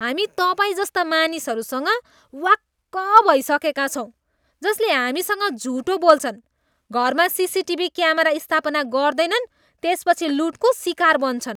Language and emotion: Nepali, disgusted